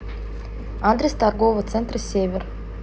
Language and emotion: Russian, neutral